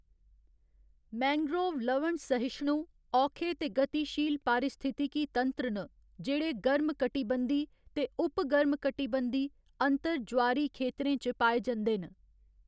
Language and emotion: Dogri, neutral